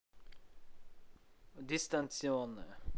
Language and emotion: Russian, neutral